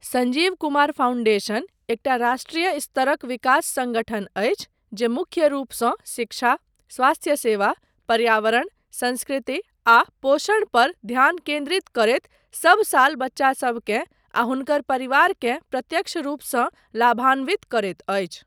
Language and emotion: Maithili, neutral